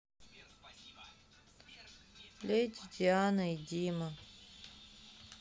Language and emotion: Russian, sad